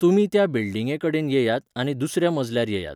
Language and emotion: Goan Konkani, neutral